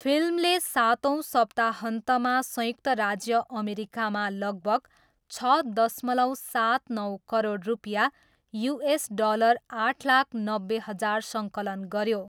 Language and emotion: Nepali, neutral